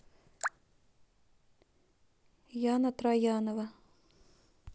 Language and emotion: Russian, neutral